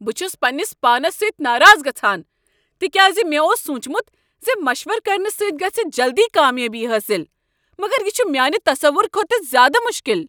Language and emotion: Kashmiri, angry